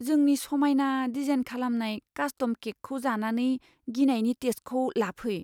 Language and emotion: Bodo, fearful